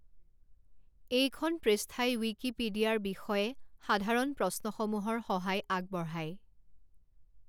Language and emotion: Assamese, neutral